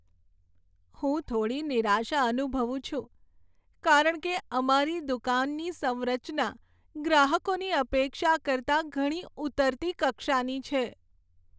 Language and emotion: Gujarati, sad